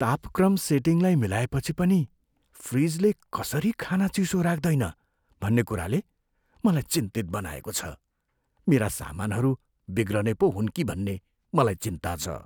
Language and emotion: Nepali, fearful